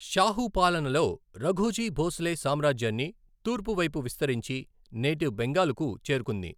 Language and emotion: Telugu, neutral